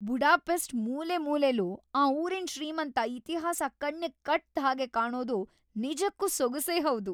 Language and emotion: Kannada, happy